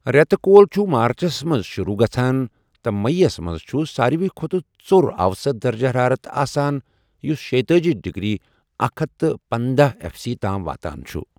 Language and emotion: Kashmiri, neutral